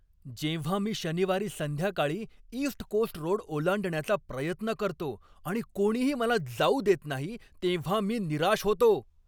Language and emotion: Marathi, angry